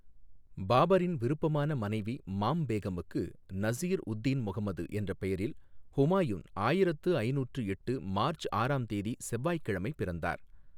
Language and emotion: Tamil, neutral